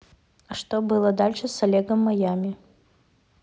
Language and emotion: Russian, neutral